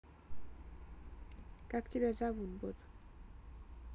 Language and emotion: Russian, neutral